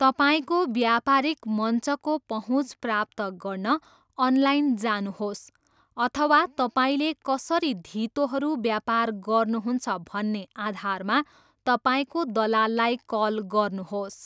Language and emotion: Nepali, neutral